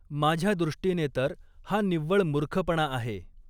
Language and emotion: Marathi, neutral